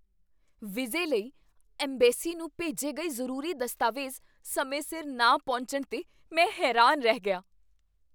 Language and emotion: Punjabi, surprised